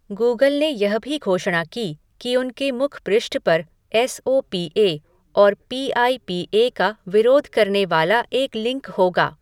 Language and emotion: Hindi, neutral